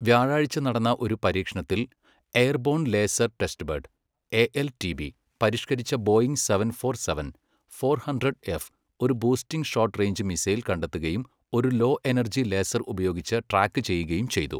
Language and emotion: Malayalam, neutral